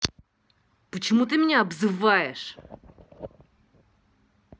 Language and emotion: Russian, angry